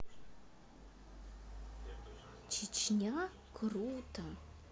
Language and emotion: Russian, neutral